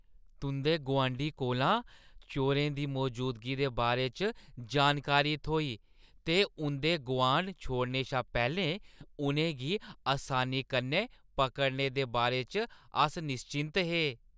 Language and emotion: Dogri, happy